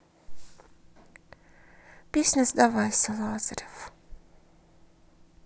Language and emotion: Russian, neutral